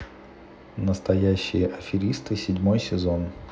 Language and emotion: Russian, neutral